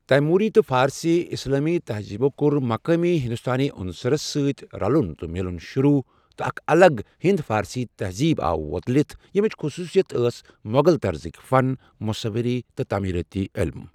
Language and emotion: Kashmiri, neutral